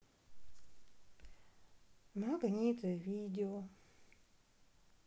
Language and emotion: Russian, neutral